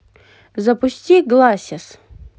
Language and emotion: Russian, neutral